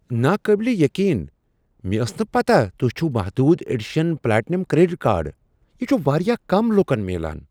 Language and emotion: Kashmiri, surprised